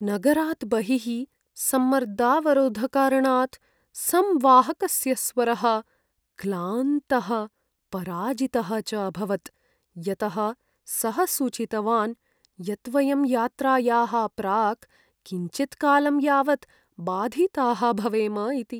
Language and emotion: Sanskrit, sad